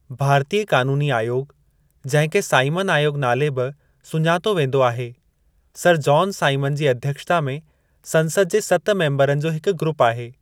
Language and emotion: Sindhi, neutral